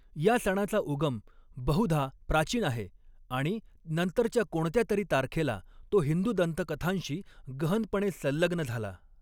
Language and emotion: Marathi, neutral